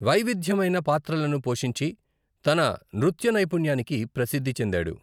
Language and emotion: Telugu, neutral